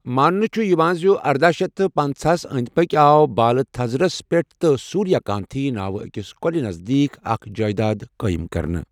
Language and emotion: Kashmiri, neutral